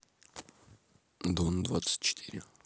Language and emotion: Russian, neutral